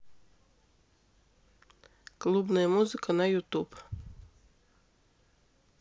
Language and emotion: Russian, neutral